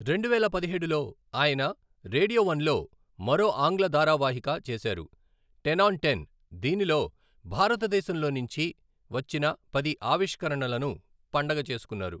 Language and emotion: Telugu, neutral